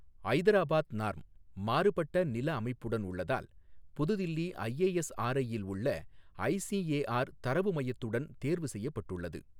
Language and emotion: Tamil, neutral